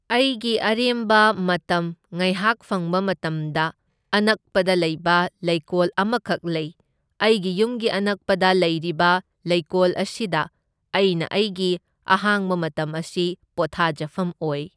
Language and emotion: Manipuri, neutral